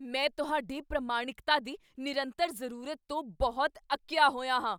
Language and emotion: Punjabi, angry